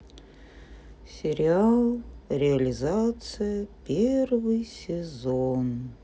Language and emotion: Russian, sad